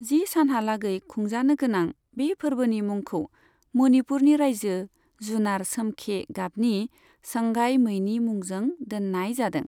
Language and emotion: Bodo, neutral